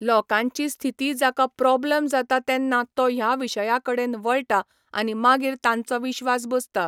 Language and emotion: Goan Konkani, neutral